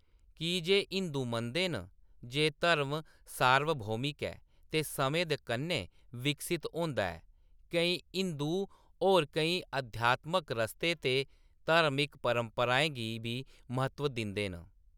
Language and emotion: Dogri, neutral